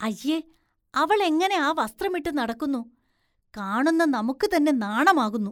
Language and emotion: Malayalam, disgusted